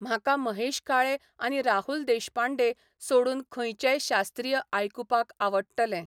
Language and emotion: Goan Konkani, neutral